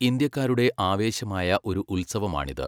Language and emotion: Malayalam, neutral